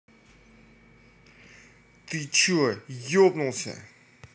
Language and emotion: Russian, angry